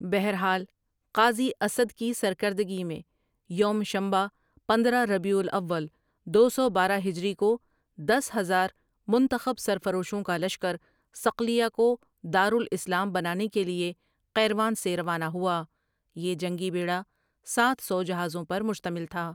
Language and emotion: Urdu, neutral